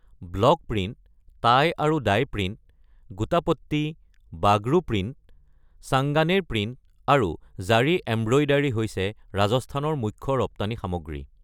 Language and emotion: Assamese, neutral